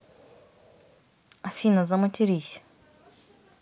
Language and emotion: Russian, neutral